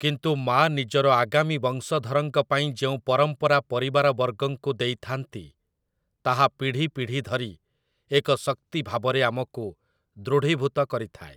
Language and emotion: Odia, neutral